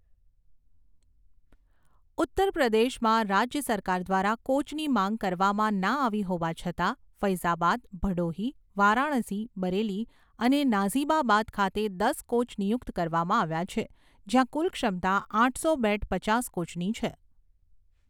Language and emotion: Gujarati, neutral